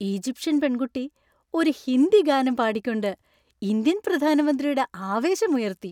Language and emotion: Malayalam, happy